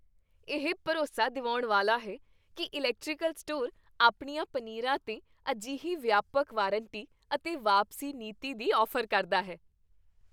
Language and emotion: Punjabi, happy